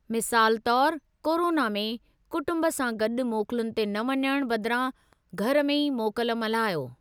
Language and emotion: Sindhi, neutral